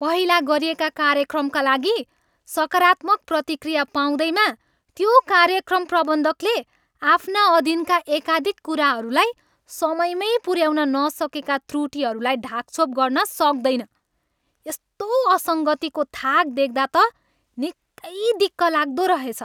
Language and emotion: Nepali, angry